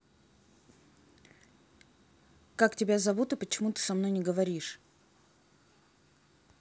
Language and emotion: Russian, neutral